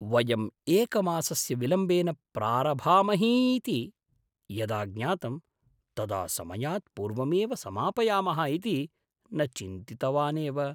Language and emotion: Sanskrit, surprised